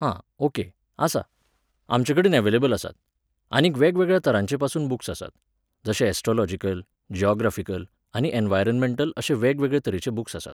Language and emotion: Goan Konkani, neutral